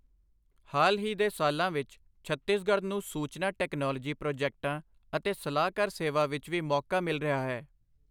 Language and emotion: Punjabi, neutral